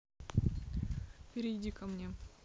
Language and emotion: Russian, neutral